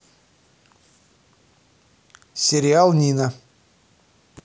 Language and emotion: Russian, neutral